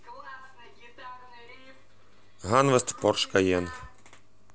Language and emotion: Russian, neutral